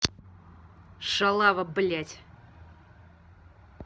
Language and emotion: Russian, angry